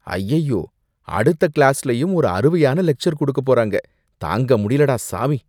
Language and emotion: Tamil, disgusted